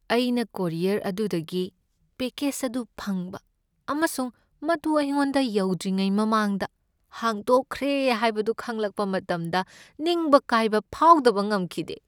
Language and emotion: Manipuri, sad